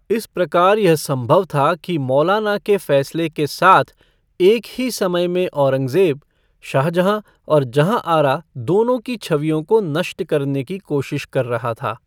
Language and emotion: Hindi, neutral